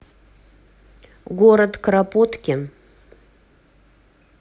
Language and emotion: Russian, neutral